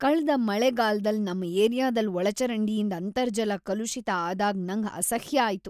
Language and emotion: Kannada, disgusted